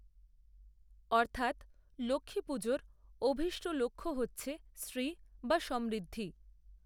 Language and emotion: Bengali, neutral